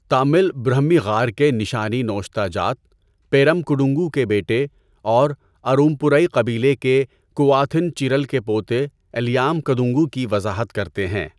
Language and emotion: Urdu, neutral